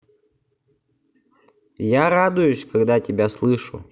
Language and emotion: Russian, positive